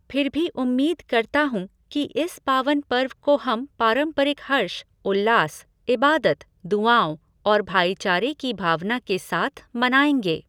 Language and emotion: Hindi, neutral